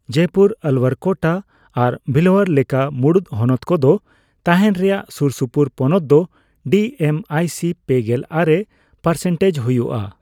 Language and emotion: Santali, neutral